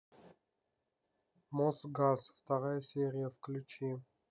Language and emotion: Russian, neutral